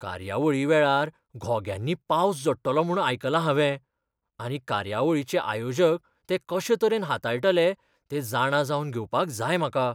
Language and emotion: Goan Konkani, fearful